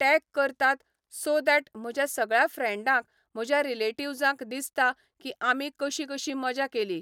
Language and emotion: Goan Konkani, neutral